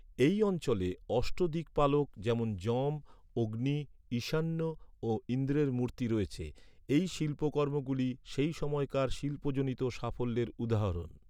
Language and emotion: Bengali, neutral